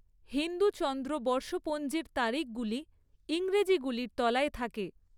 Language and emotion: Bengali, neutral